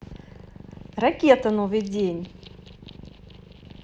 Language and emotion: Russian, positive